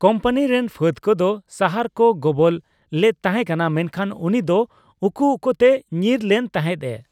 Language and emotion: Santali, neutral